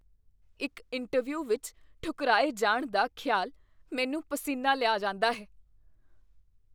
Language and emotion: Punjabi, fearful